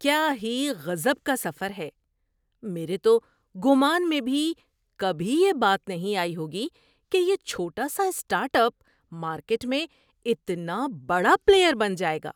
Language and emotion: Urdu, surprised